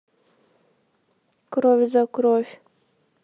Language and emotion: Russian, neutral